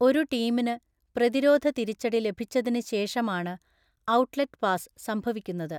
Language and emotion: Malayalam, neutral